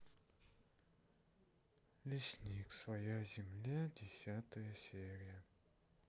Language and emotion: Russian, sad